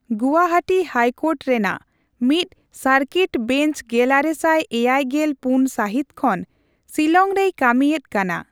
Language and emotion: Santali, neutral